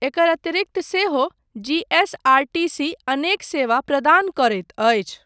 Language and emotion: Maithili, neutral